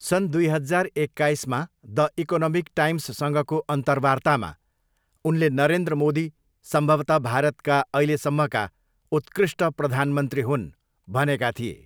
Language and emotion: Nepali, neutral